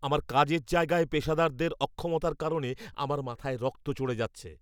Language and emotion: Bengali, angry